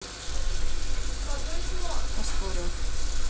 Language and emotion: Russian, neutral